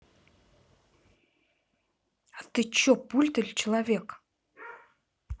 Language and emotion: Russian, angry